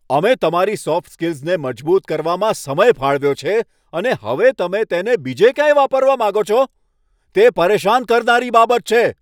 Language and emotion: Gujarati, angry